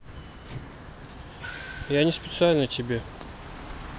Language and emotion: Russian, sad